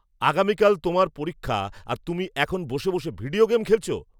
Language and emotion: Bengali, angry